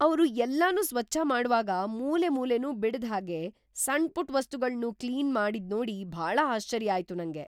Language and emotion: Kannada, surprised